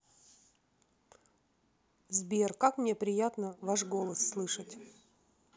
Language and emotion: Russian, neutral